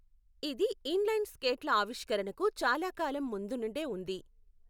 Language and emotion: Telugu, neutral